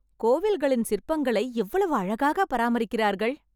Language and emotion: Tamil, happy